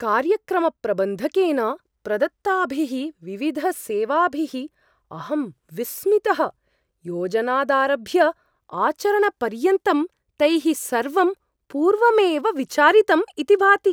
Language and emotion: Sanskrit, surprised